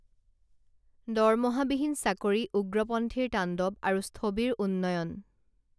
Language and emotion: Assamese, neutral